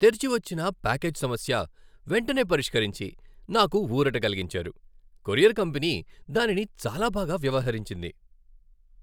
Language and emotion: Telugu, happy